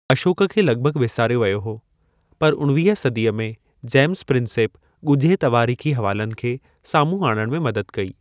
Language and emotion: Sindhi, neutral